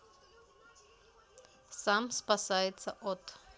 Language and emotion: Russian, neutral